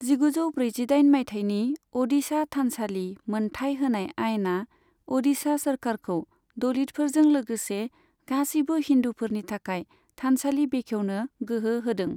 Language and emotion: Bodo, neutral